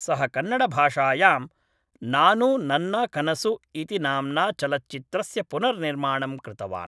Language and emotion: Sanskrit, neutral